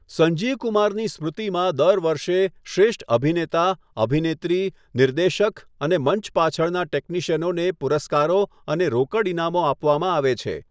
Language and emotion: Gujarati, neutral